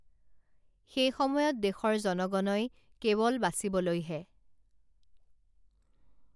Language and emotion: Assamese, neutral